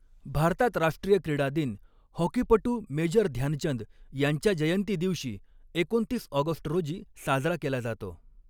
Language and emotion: Marathi, neutral